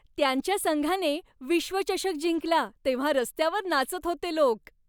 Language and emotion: Marathi, happy